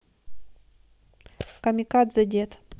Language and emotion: Russian, neutral